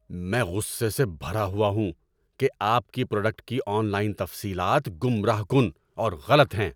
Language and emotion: Urdu, angry